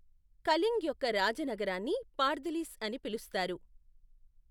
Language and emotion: Telugu, neutral